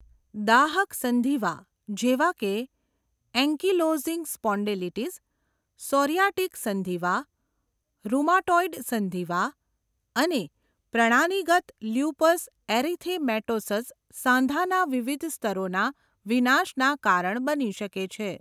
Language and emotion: Gujarati, neutral